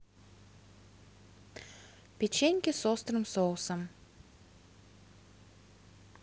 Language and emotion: Russian, neutral